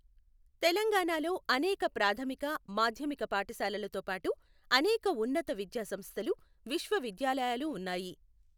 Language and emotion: Telugu, neutral